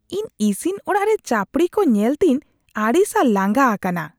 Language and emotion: Santali, disgusted